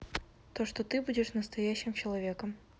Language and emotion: Russian, neutral